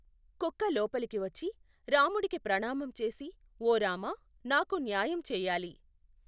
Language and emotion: Telugu, neutral